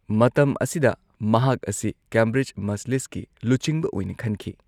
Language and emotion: Manipuri, neutral